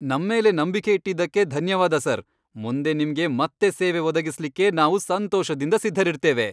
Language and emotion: Kannada, happy